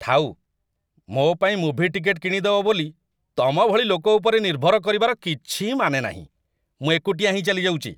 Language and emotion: Odia, disgusted